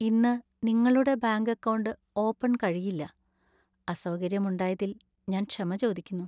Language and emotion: Malayalam, sad